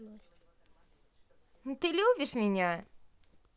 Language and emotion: Russian, positive